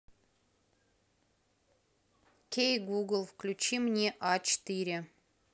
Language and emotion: Russian, neutral